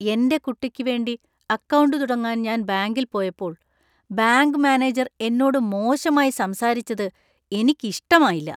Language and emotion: Malayalam, disgusted